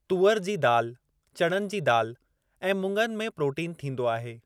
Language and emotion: Sindhi, neutral